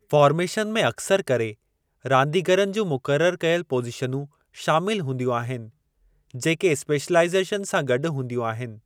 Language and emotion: Sindhi, neutral